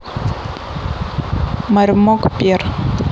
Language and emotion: Russian, neutral